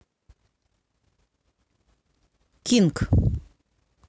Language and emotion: Russian, neutral